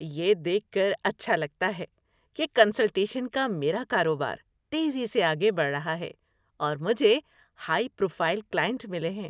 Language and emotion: Urdu, happy